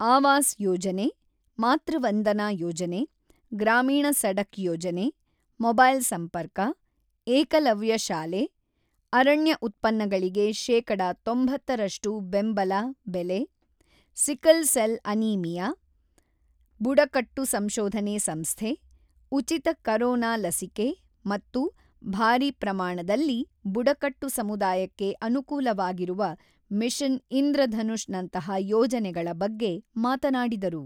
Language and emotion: Kannada, neutral